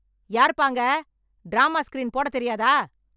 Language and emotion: Tamil, angry